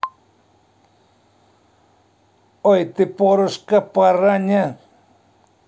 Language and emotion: Russian, neutral